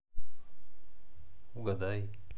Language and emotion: Russian, neutral